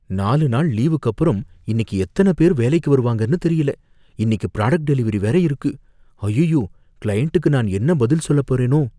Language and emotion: Tamil, fearful